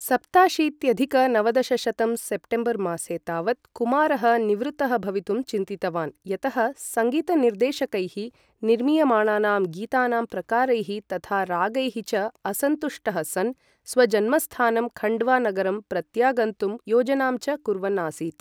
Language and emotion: Sanskrit, neutral